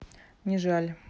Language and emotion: Russian, neutral